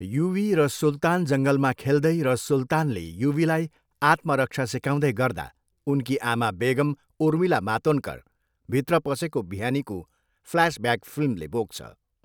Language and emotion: Nepali, neutral